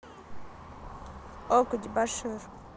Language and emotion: Russian, neutral